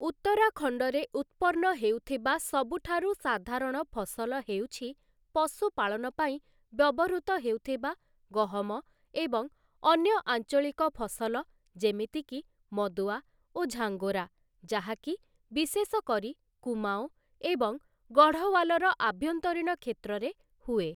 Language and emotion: Odia, neutral